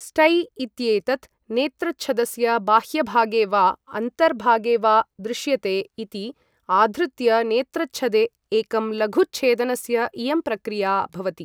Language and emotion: Sanskrit, neutral